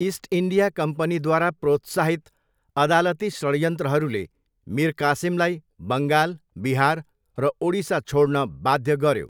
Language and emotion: Nepali, neutral